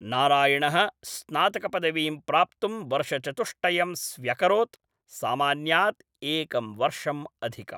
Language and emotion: Sanskrit, neutral